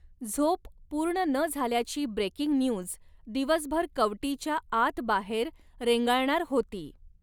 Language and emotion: Marathi, neutral